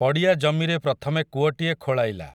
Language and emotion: Odia, neutral